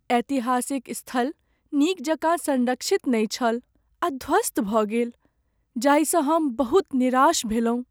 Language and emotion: Maithili, sad